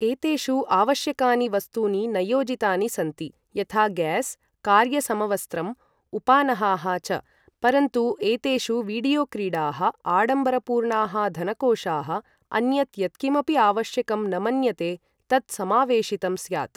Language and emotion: Sanskrit, neutral